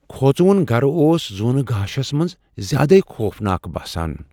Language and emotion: Kashmiri, fearful